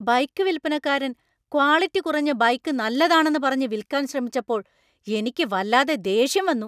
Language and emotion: Malayalam, angry